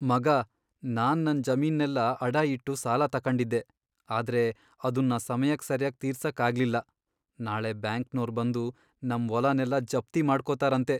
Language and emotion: Kannada, sad